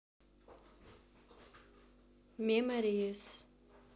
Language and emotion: Russian, neutral